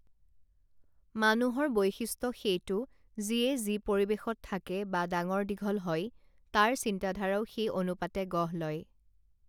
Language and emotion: Assamese, neutral